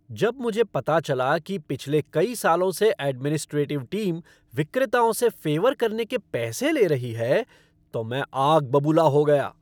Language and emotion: Hindi, angry